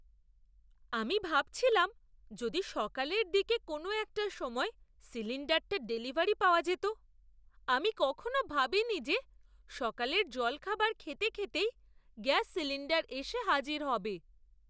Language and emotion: Bengali, surprised